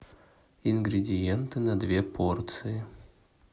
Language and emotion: Russian, neutral